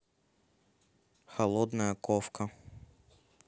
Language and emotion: Russian, neutral